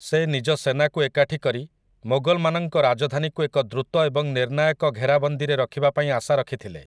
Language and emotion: Odia, neutral